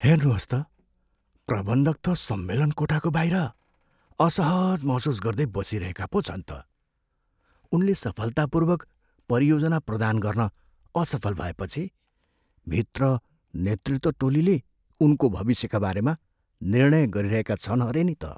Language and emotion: Nepali, fearful